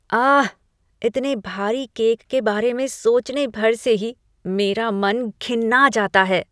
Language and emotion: Hindi, disgusted